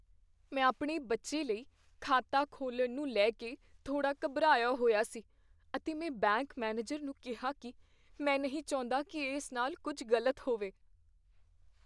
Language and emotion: Punjabi, fearful